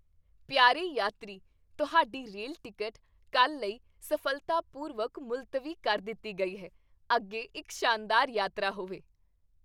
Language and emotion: Punjabi, happy